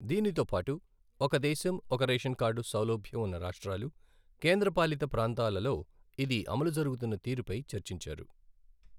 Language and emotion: Telugu, neutral